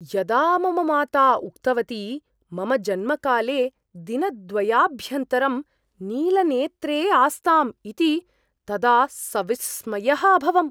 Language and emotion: Sanskrit, surprised